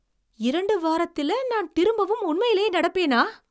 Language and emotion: Tamil, surprised